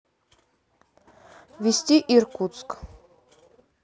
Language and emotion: Russian, neutral